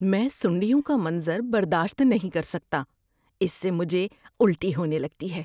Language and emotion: Urdu, disgusted